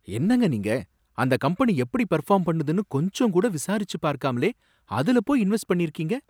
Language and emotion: Tamil, surprised